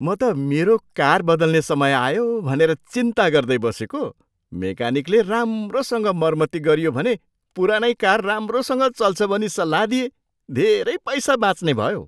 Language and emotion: Nepali, surprised